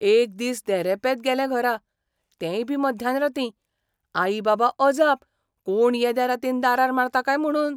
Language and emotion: Goan Konkani, surprised